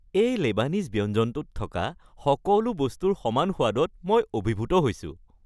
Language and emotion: Assamese, happy